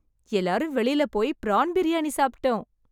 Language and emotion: Tamil, happy